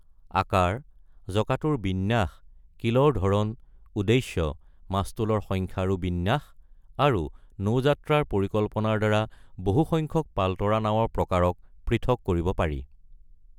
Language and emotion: Assamese, neutral